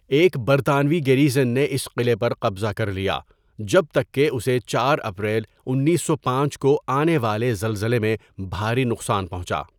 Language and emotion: Urdu, neutral